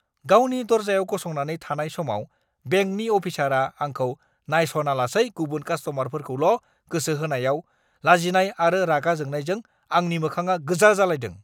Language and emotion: Bodo, angry